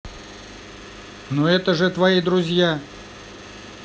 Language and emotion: Russian, neutral